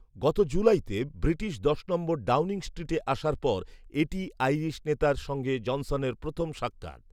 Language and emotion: Bengali, neutral